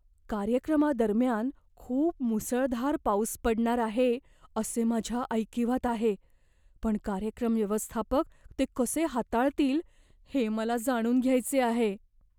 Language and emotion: Marathi, fearful